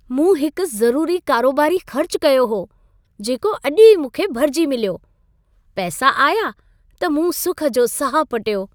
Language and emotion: Sindhi, happy